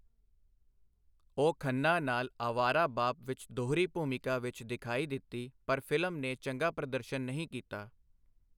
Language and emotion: Punjabi, neutral